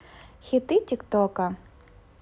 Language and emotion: Russian, positive